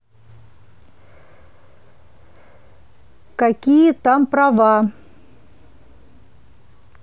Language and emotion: Russian, neutral